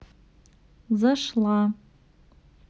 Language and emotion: Russian, neutral